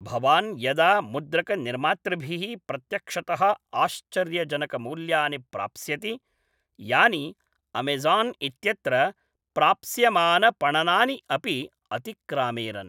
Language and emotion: Sanskrit, neutral